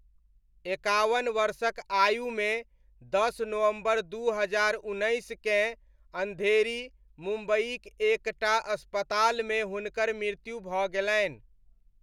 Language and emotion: Maithili, neutral